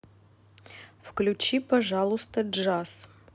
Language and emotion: Russian, neutral